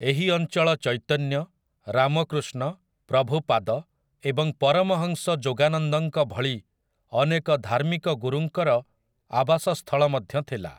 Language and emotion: Odia, neutral